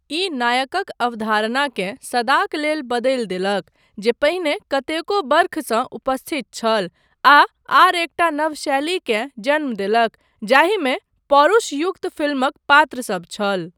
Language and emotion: Maithili, neutral